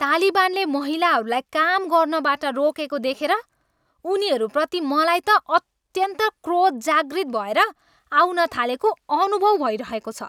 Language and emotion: Nepali, angry